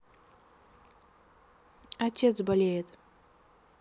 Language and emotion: Russian, sad